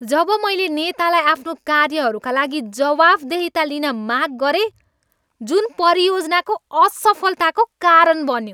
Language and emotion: Nepali, angry